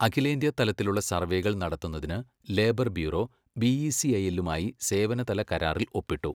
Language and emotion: Malayalam, neutral